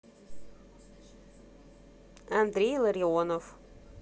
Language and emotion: Russian, neutral